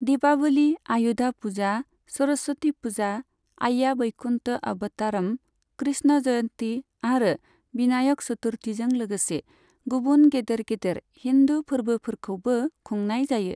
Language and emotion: Bodo, neutral